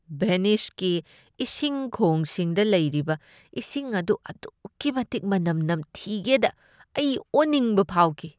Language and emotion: Manipuri, disgusted